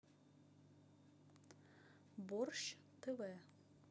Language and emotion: Russian, neutral